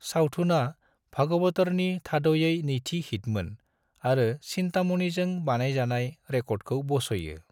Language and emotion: Bodo, neutral